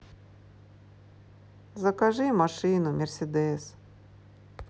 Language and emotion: Russian, sad